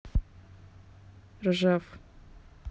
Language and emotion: Russian, neutral